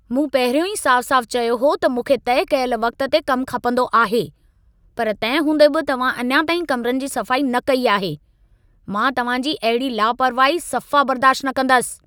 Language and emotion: Sindhi, angry